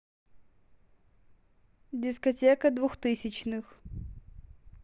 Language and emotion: Russian, neutral